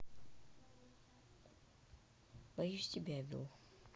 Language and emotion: Russian, sad